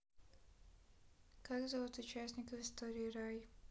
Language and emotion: Russian, neutral